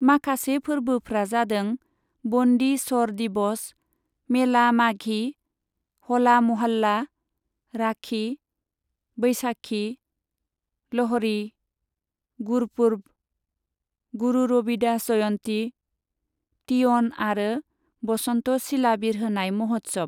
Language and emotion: Bodo, neutral